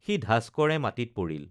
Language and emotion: Assamese, neutral